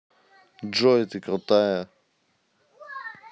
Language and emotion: Russian, neutral